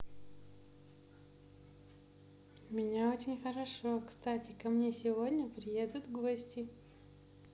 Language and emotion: Russian, positive